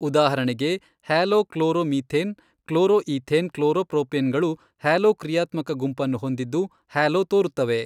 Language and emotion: Kannada, neutral